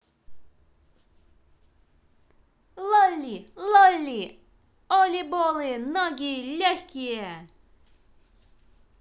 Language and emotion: Russian, positive